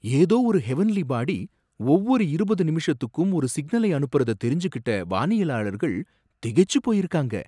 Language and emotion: Tamil, surprised